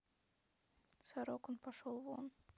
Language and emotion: Russian, sad